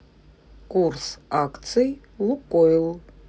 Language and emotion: Russian, neutral